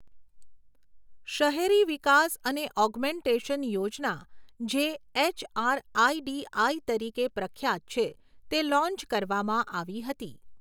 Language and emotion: Gujarati, neutral